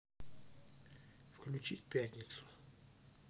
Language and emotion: Russian, neutral